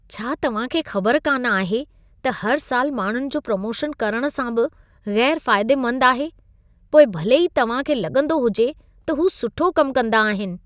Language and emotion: Sindhi, disgusted